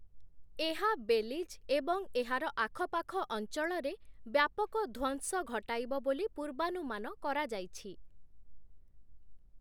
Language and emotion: Odia, neutral